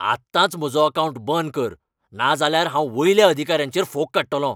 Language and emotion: Goan Konkani, angry